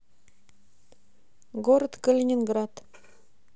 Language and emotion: Russian, neutral